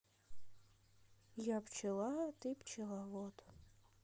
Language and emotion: Russian, sad